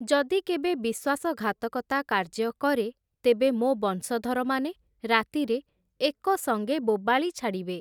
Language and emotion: Odia, neutral